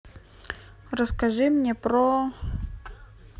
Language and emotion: Russian, neutral